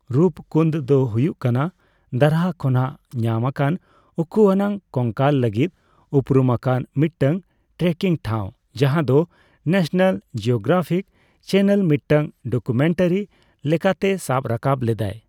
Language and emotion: Santali, neutral